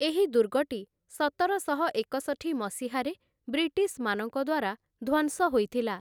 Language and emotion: Odia, neutral